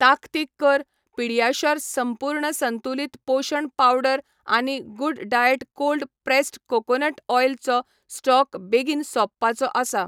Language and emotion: Goan Konkani, neutral